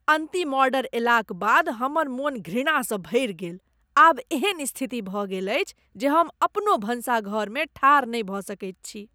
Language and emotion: Maithili, disgusted